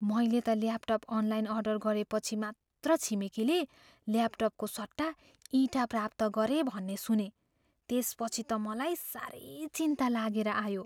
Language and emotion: Nepali, fearful